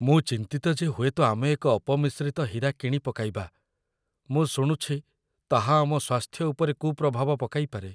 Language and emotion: Odia, fearful